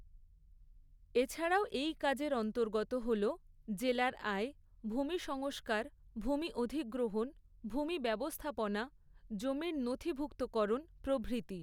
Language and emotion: Bengali, neutral